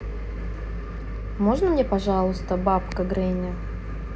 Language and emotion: Russian, neutral